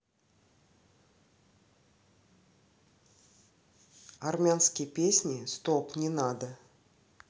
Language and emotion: Russian, neutral